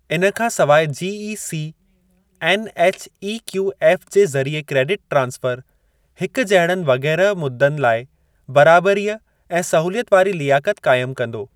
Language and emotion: Sindhi, neutral